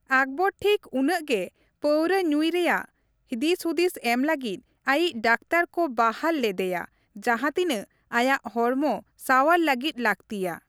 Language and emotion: Santali, neutral